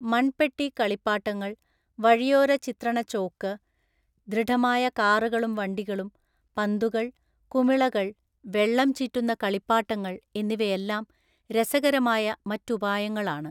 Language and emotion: Malayalam, neutral